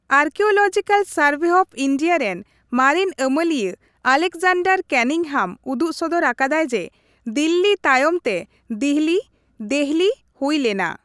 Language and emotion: Santali, neutral